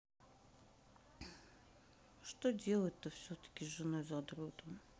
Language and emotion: Russian, sad